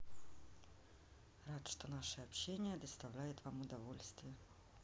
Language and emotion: Russian, neutral